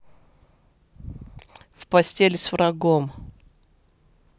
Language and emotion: Russian, neutral